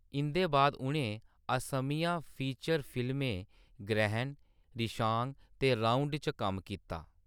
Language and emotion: Dogri, neutral